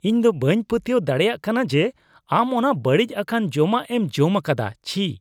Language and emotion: Santali, disgusted